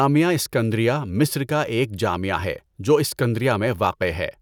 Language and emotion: Urdu, neutral